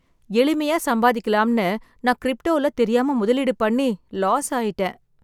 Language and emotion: Tamil, sad